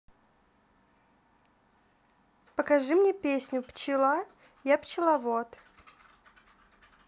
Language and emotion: Russian, neutral